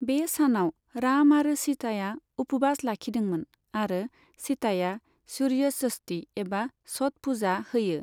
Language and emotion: Bodo, neutral